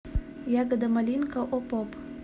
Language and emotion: Russian, neutral